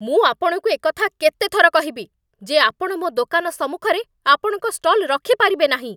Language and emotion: Odia, angry